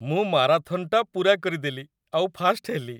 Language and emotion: Odia, happy